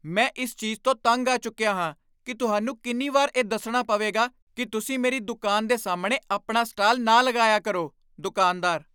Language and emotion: Punjabi, angry